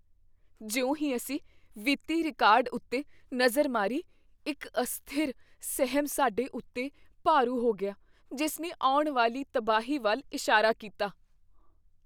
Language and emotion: Punjabi, fearful